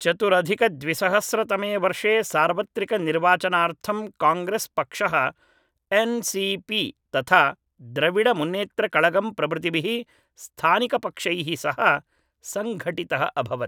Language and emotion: Sanskrit, neutral